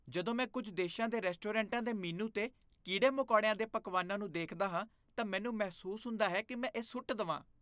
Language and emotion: Punjabi, disgusted